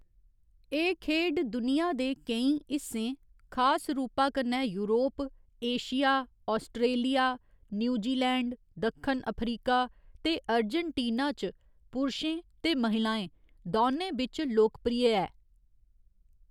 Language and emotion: Dogri, neutral